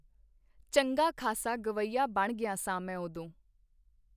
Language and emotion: Punjabi, neutral